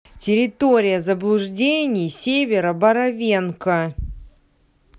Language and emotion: Russian, neutral